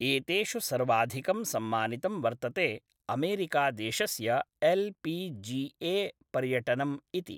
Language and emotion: Sanskrit, neutral